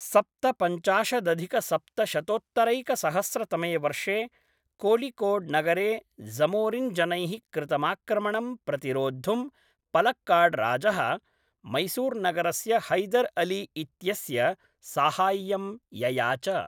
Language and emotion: Sanskrit, neutral